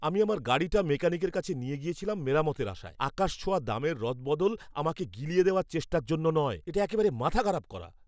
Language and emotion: Bengali, angry